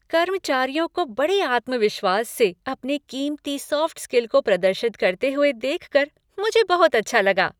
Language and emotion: Hindi, happy